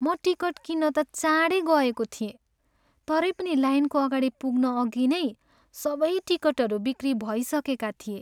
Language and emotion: Nepali, sad